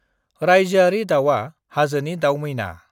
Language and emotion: Bodo, neutral